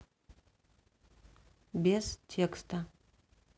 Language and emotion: Russian, neutral